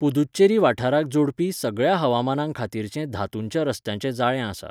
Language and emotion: Goan Konkani, neutral